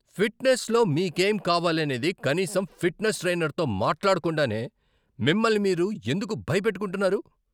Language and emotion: Telugu, angry